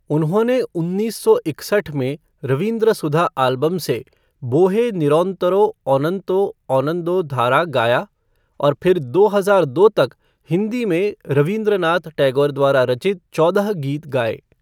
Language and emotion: Hindi, neutral